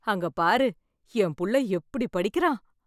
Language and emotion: Tamil, happy